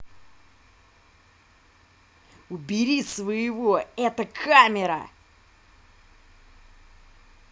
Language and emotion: Russian, angry